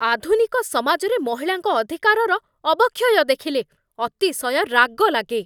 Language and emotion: Odia, angry